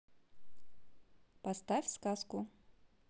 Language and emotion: Russian, neutral